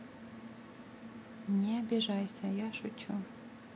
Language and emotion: Russian, neutral